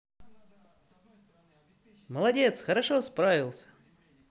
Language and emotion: Russian, positive